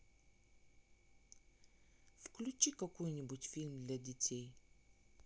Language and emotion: Russian, neutral